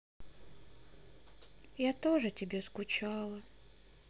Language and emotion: Russian, sad